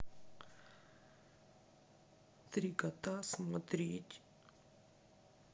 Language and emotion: Russian, sad